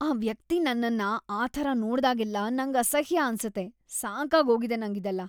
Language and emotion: Kannada, disgusted